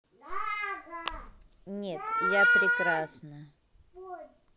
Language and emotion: Russian, neutral